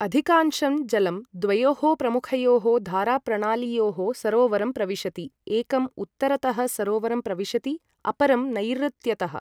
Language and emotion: Sanskrit, neutral